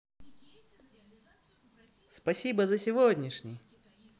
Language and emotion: Russian, positive